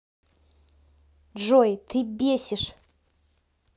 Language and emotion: Russian, angry